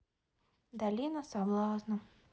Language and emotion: Russian, sad